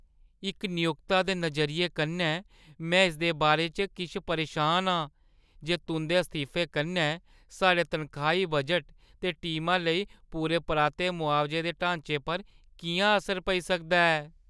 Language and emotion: Dogri, fearful